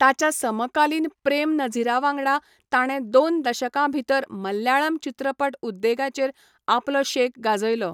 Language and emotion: Goan Konkani, neutral